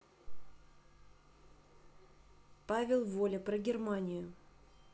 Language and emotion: Russian, neutral